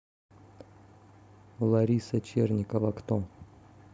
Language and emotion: Russian, neutral